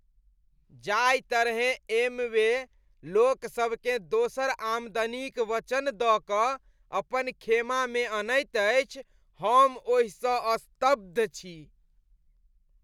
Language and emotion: Maithili, disgusted